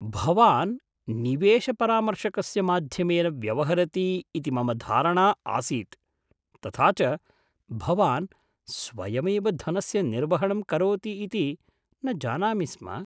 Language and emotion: Sanskrit, surprised